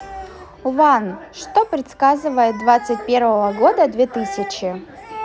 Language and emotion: Russian, neutral